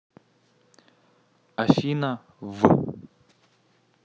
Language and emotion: Russian, neutral